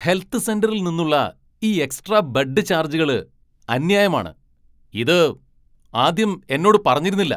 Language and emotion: Malayalam, angry